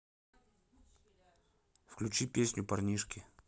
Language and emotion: Russian, neutral